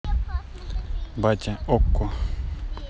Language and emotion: Russian, neutral